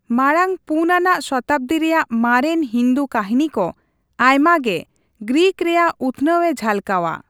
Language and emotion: Santali, neutral